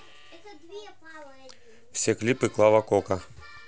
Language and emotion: Russian, neutral